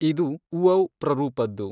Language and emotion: Kannada, neutral